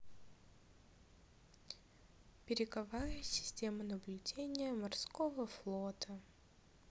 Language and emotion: Russian, sad